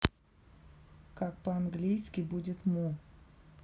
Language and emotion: Russian, neutral